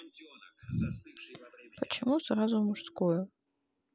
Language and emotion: Russian, sad